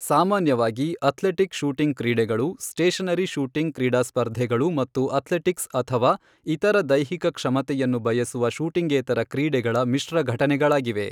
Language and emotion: Kannada, neutral